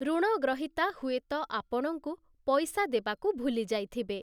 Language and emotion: Odia, neutral